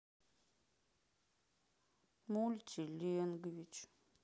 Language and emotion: Russian, sad